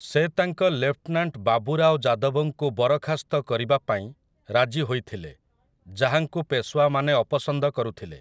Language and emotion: Odia, neutral